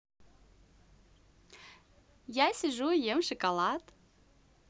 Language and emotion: Russian, positive